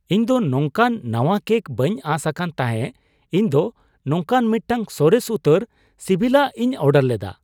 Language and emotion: Santali, surprised